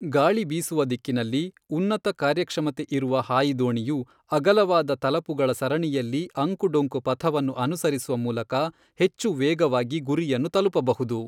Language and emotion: Kannada, neutral